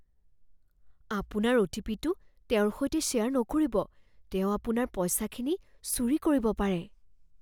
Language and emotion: Assamese, fearful